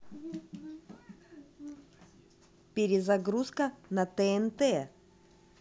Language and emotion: Russian, positive